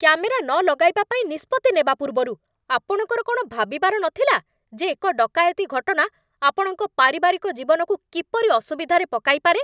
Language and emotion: Odia, angry